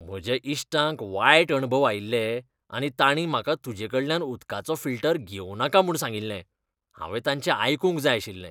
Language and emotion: Goan Konkani, disgusted